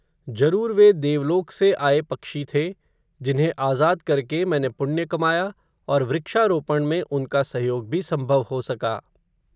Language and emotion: Hindi, neutral